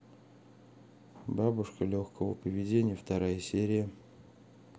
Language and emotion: Russian, neutral